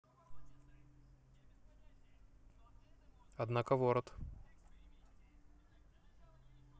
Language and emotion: Russian, neutral